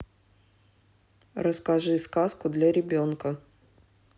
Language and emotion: Russian, neutral